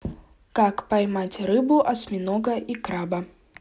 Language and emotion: Russian, neutral